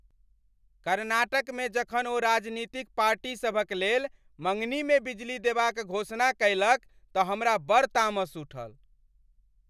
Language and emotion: Maithili, angry